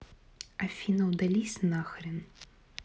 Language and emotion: Russian, angry